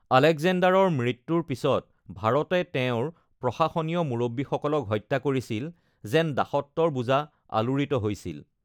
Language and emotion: Assamese, neutral